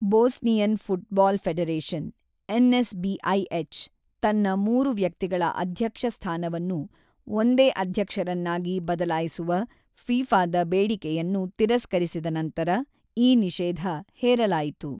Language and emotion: Kannada, neutral